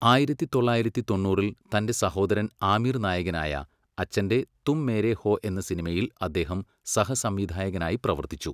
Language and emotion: Malayalam, neutral